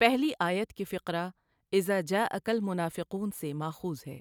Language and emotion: Urdu, neutral